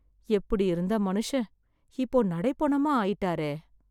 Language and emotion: Tamil, sad